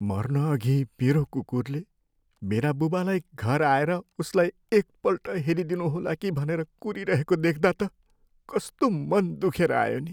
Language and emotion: Nepali, sad